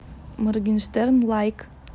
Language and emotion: Russian, neutral